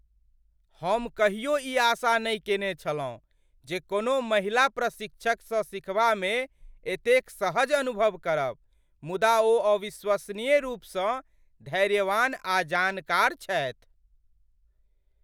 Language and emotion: Maithili, surprised